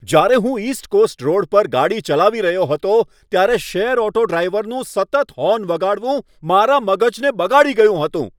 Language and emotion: Gujarati, angry